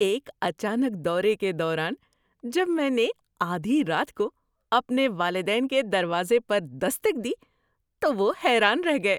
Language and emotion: Urdu, surprised